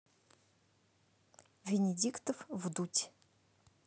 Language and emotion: Russian, neutral